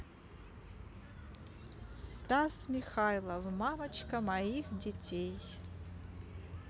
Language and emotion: Russian, neutral